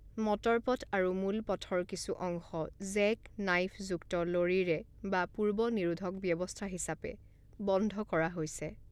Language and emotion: Assamese, neutral